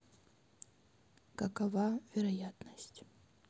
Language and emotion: Russian, sad